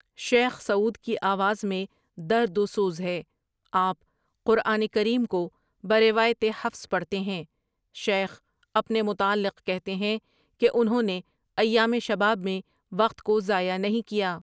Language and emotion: Urdu, neutral